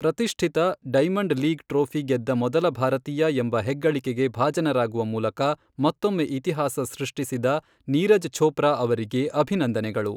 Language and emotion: Kannada, neutral